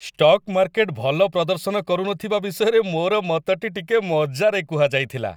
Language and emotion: Odia, happy